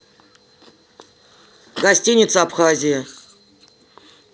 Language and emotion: Russian, neutral